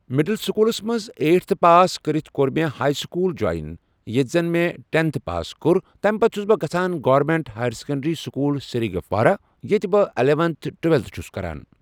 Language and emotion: Kashmiri, neutral